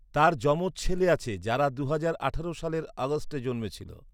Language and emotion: Bengali, neutral